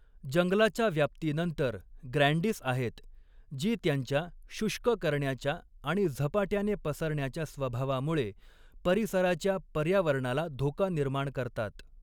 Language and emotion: Marathi, neutral